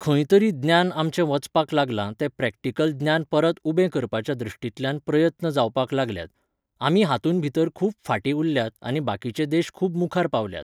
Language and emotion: Goan Konkani, neutral